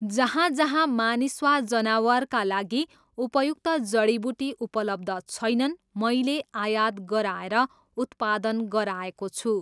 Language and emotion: Nepali, neutral